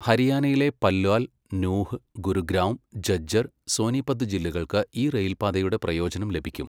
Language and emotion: Malayalam, neutral